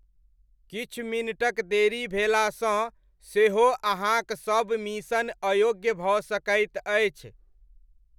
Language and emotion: Maithili, neutral